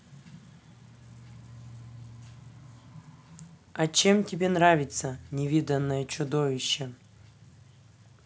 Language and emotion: Russian, neutral